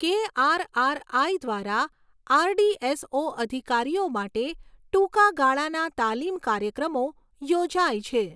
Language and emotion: Gujarati, neutral